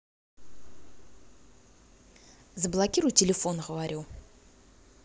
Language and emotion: Russian, angry